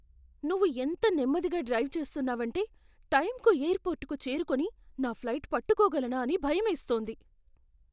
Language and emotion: Telugu, fearful